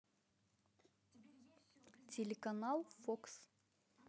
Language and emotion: Russian, neutral